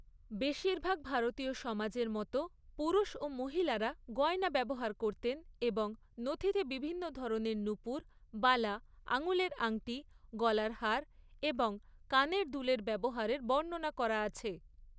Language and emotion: Bengali, neutral